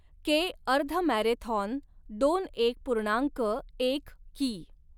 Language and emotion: Marathi, neutral